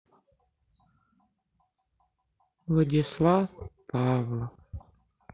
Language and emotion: Russian, sad